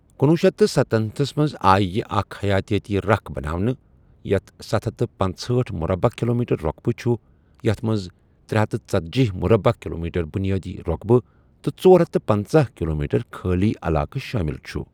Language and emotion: Kashmiri, neutral